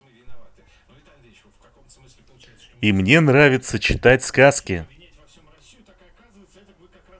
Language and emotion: Russian, positive